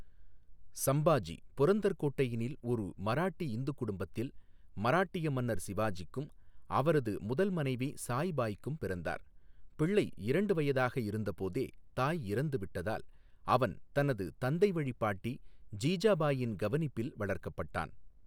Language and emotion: Tamil, neutral